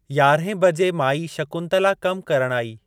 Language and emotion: Sindhi, neutral